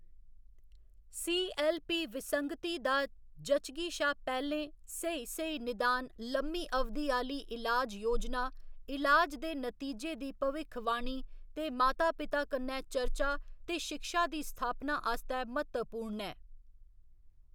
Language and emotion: Dogri, neutral